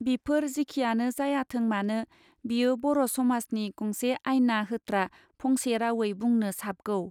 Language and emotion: Bodo, neutral